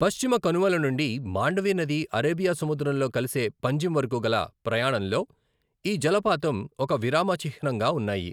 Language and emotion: Telugu, neutral